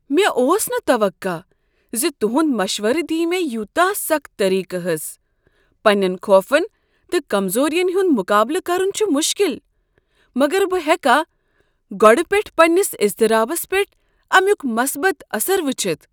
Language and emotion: Kashmiri, surprised